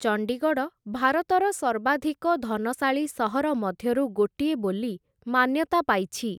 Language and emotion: Odia, neutral